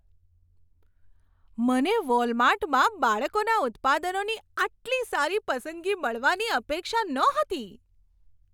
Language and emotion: Gujarati, surprised